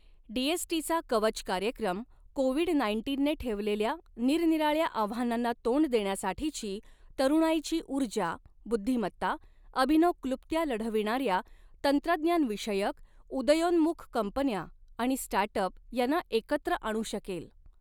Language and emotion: Marathi, neutral